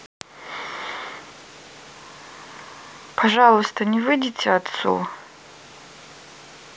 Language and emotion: Russian, sad